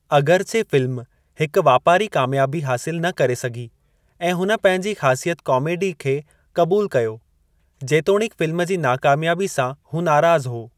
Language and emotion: Sindhi, neutral